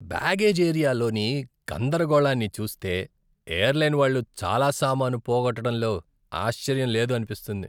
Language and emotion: Telugu, disgusted